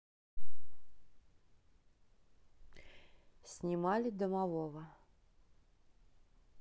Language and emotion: Russian, neutral